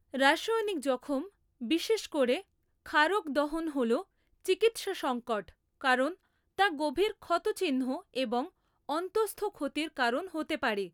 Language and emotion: Bengali, neutral